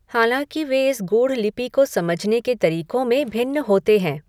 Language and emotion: Hindi, neutral